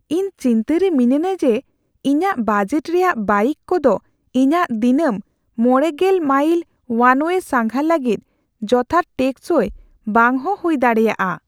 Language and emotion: Santali, fearful